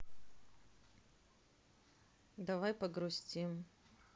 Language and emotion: Russian, sad